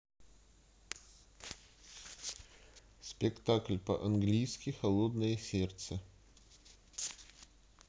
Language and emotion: Russian, neutral